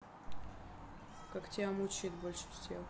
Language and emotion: Russian, sad